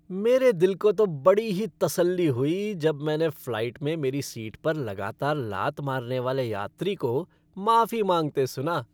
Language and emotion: Hindi, happy